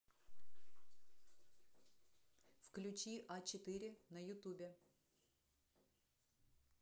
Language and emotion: Russian, neutral